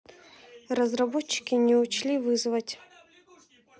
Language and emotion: Russian, neutral